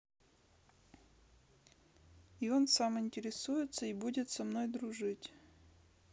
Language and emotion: Russian, sad